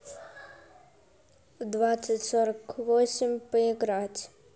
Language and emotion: Russian, neutral